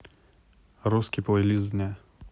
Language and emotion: Russian, neutral